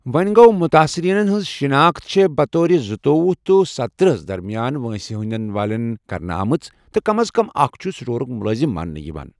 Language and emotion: Kashmiri, neutral